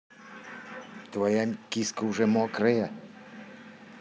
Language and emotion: Russian, neutral